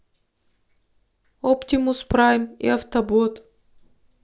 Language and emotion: Russian, neutral